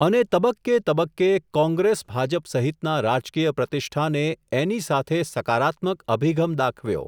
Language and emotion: Gujarati, neutral